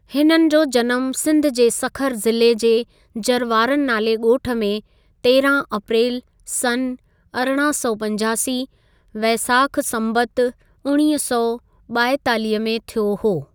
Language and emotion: Sindhi, neutral